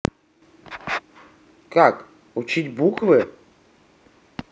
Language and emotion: Russian, neutral